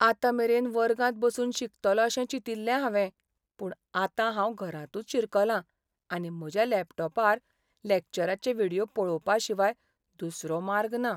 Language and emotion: Goan Konkani, sad